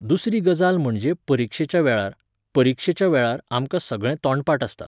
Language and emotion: Goan Konkani, neutral